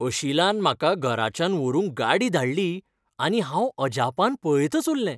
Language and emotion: Goan Konkani, happy